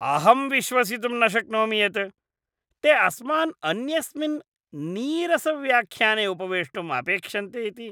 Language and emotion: Sanskrit, disgusted